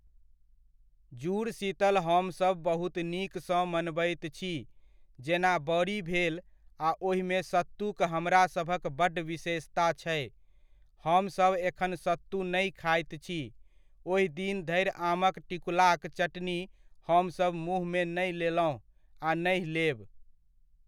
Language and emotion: Maithili, neutral